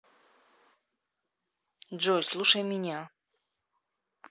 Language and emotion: Russian, neutral